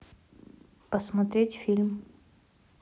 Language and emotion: Russian, neutral